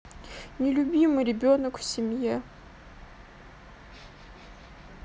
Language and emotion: Russian, sad